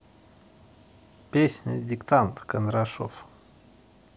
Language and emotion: Russian, neutral